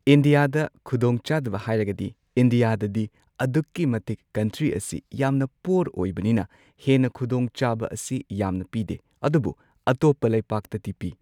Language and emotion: Manipuri, neutral